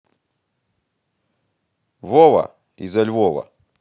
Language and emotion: Russian, positive